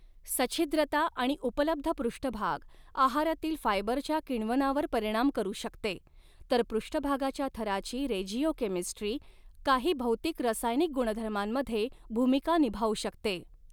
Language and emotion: Marathi, neutral